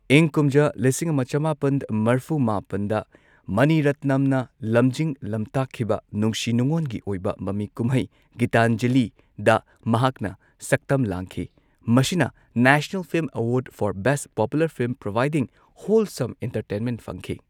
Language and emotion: Manipuri, neutral